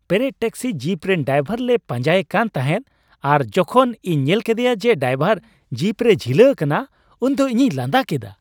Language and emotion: Santali, happy